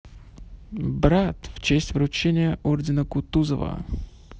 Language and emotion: Russian, positive